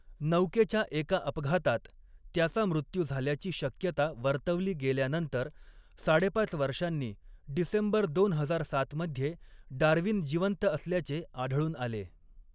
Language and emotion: Marathi, neutral